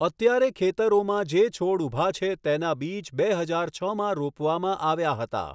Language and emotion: Gujarati, neutral